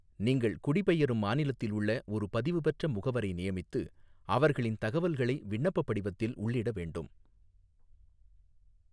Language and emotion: Tamil, neutral